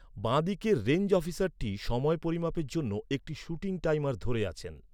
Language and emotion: Bengali, neutral